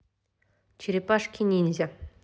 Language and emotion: Russian, neutral